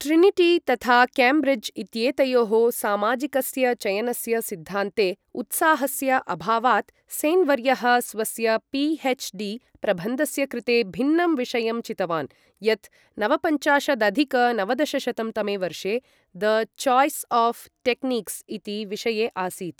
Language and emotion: Sanskrit, neutral